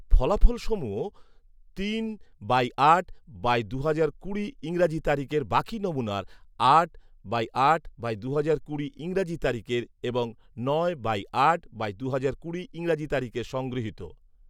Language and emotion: Bengali, neutral